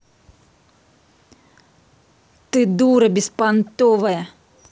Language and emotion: Russian, angry